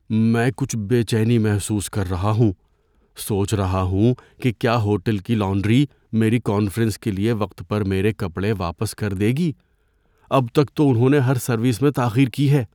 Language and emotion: Urdu, fearful